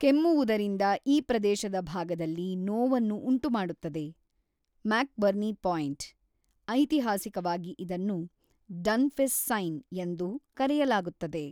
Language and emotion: Kannada, neutral